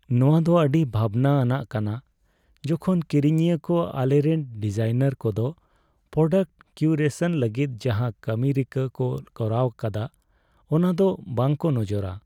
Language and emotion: Santali, sad